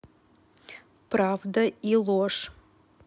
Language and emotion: Russian, neutral